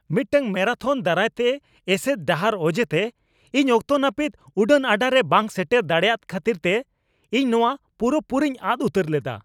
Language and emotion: Santali, angry